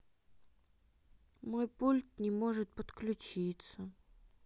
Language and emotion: Russian, sad